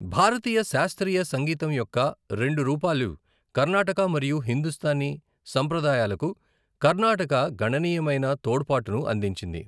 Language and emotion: Telugu, neutral